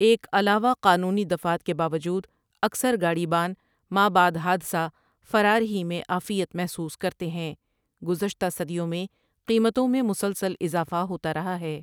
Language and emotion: Urdu, neutral